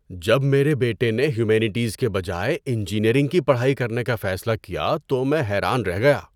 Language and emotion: Urdu, surprised